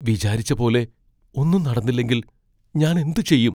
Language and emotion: Malayalam, fearful